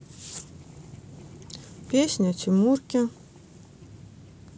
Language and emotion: Russian, neutral